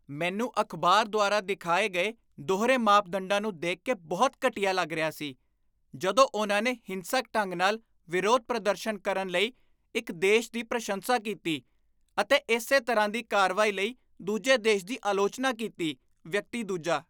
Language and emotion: Punjabi, disgusted